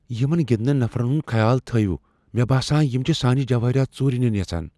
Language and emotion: Kashmiri, fearful